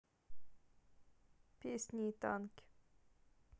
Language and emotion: Russian, neutral